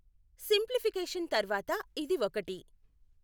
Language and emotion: Telugu, neutral